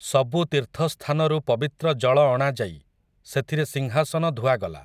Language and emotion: Odia, neutral